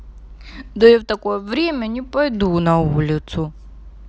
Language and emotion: Russian, sad